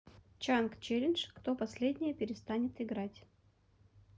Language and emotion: Russian, neutral